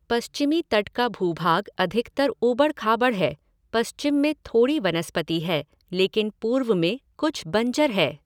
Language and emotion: Hindi, neutral